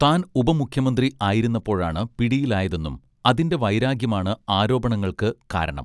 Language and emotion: Malayalam, neutral